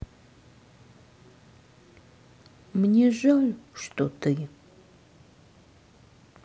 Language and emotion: Russian, sad